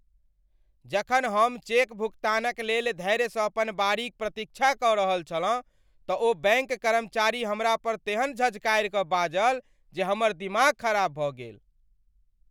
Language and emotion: Maithili, angry